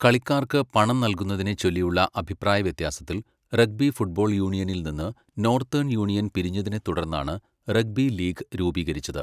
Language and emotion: Malayalam, neutral